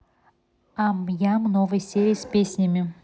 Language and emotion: Russian, neutral